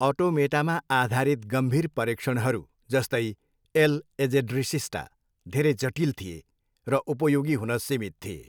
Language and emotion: Nepali, neutral